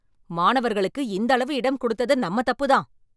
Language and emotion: Tamil, angry